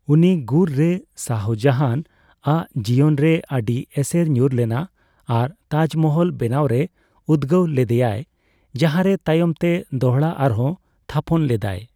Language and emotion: Santali, neutral